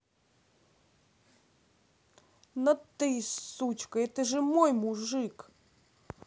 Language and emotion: Russian, angry